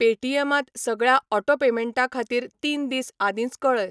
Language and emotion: Goan Konkani, neutral